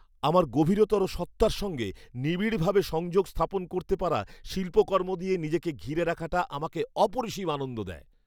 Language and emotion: Bengali, happy